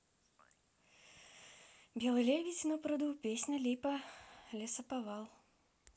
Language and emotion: Russian, neutral